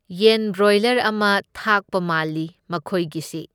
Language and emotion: Manipuri, neutral